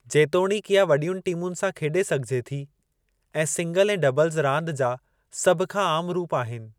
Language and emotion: Sindhi, neutral